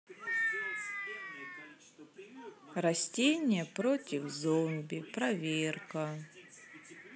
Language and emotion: Russian, sad